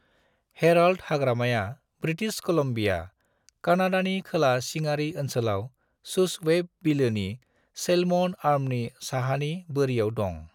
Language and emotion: Bodo, neutral